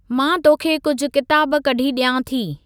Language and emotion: Sindhi, neutral